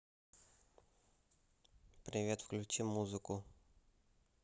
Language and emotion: Russian, neutral